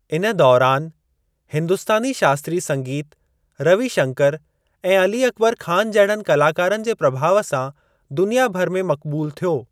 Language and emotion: Sindhi, neutral